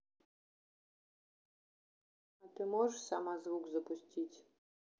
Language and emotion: Russian, neutral